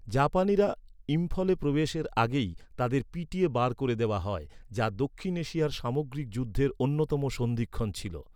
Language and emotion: Bengali, neutral